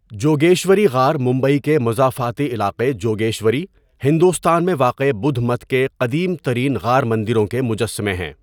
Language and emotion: Urdu, neutral